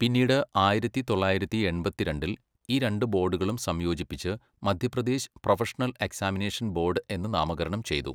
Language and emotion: Malayalam, neutral